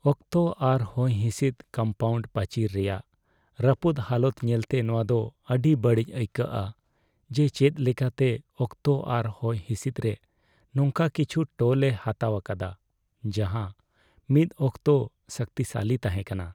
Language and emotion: Santali, sad